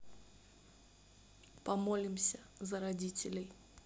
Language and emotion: Russian, neutral